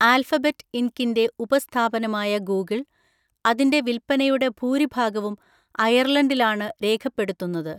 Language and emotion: Malayalam, neutral